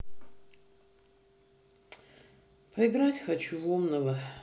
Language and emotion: Russian, sad